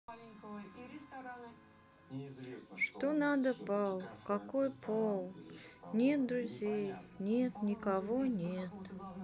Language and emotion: Russian, sad